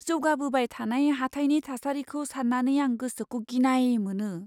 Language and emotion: Bodo, fearful